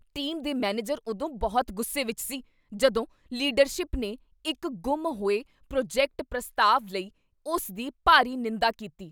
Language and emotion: Punjabi, angry